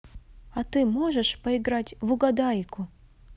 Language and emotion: Russian, positive